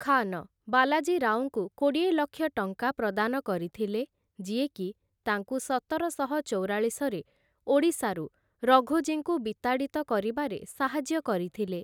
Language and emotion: Odia, neutral